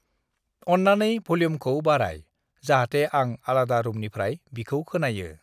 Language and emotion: Bodo, neutral